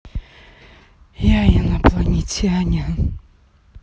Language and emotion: Russian, sad